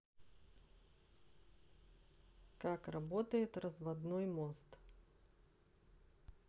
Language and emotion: Russian, neutral